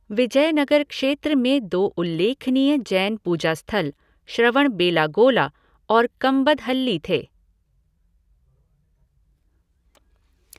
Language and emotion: Hindi, neutral